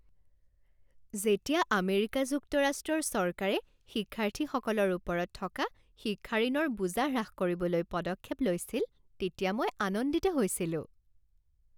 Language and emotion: Assamese, happy